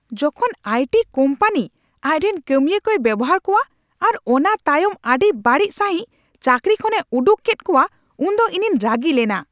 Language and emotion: Santali, angry